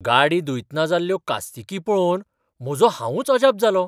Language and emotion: Goan Konkani, surprised